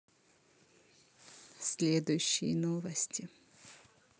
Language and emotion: Russian, neutral